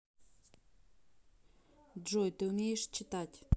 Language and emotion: Russian, neutral